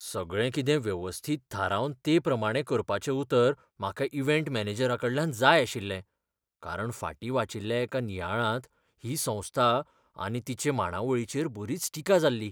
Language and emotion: Goan Konkani, fearful